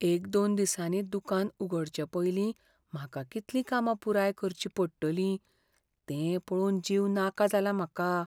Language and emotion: Goan Konkani, fearful